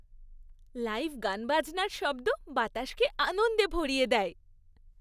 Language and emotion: Bengali, happy